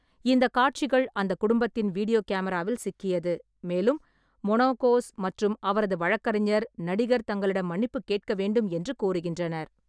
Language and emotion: Tamil, neutral